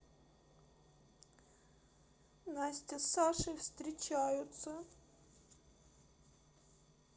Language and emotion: Russian, sad